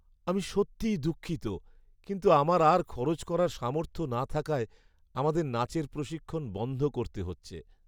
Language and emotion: Bengali, sad